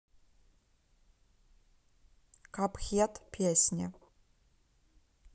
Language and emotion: Russian, neutral